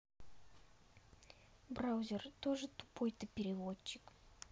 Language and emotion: Russian, neutral